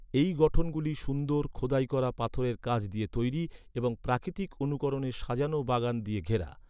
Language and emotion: Bengali, neutral